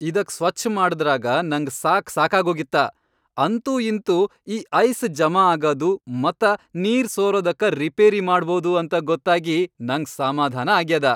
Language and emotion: Kannada, happy